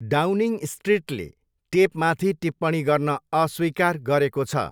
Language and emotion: Nepali, neutral